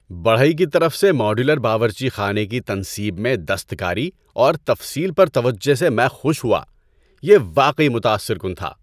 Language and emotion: Urdu, happy